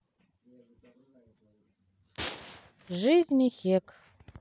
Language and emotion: Russian, neutral